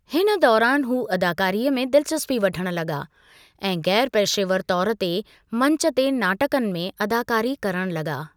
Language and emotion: Sindhi, neutral